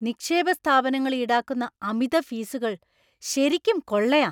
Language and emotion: Malayalam, angry